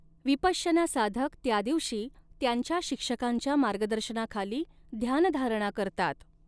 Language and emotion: Marathi, neutral